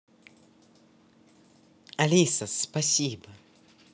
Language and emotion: Russian, positive